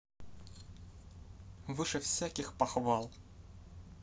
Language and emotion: Russian, positive